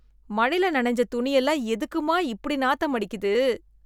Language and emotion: Tamil, disgusted